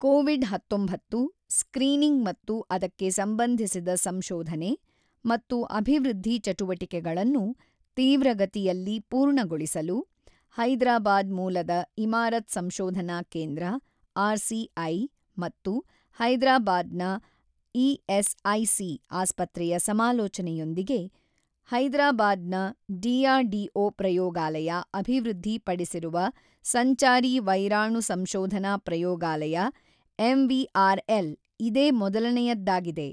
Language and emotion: Kannada, neutral